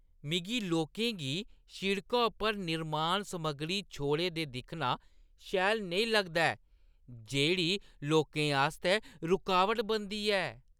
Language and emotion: Dogri, disgusted